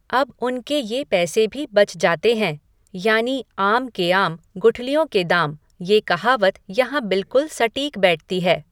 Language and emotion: Hindi, neutral